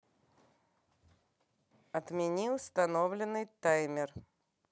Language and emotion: Russian, neutral